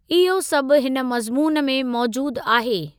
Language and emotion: Sindhi, neutral